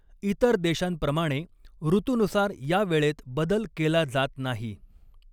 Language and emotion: Marathi, neutral